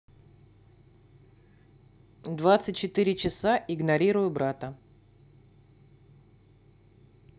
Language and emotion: Russian, neutral